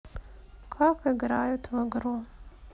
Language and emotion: Russian, sad